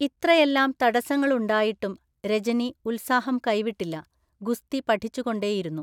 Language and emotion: Malayalam, neutral